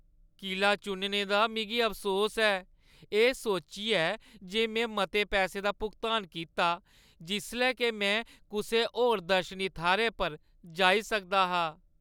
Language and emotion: Dogri, sad